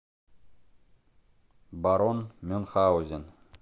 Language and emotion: Russian, neutral